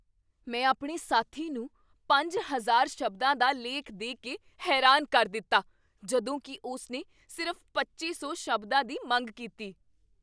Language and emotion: Punjabi, surprised